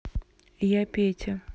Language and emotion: Russian, neutral